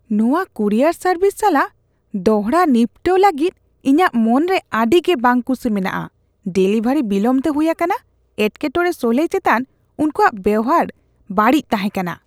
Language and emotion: Santali, disgusted